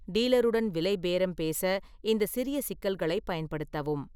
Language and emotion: Tamil, neutral